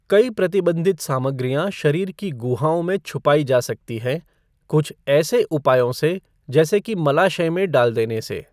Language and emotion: Hindi, neutral